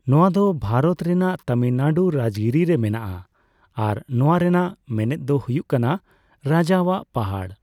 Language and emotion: Santali, neutral